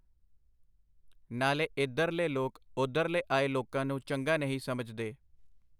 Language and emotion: Punjabi, neutral